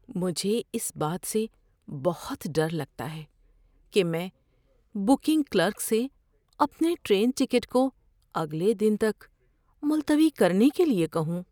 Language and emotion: Urdu, fearful